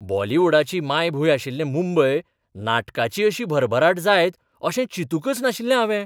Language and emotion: Goan Konkani, surprised